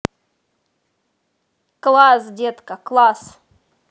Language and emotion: Russian, positive